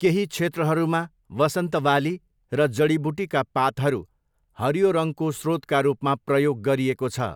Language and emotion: Nepali, neutral